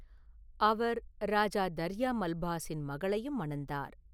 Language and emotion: Tamil, neutral